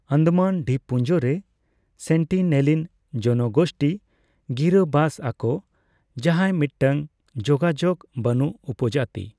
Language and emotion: Santali, neutral